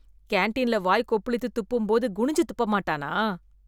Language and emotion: Tamil, disgusted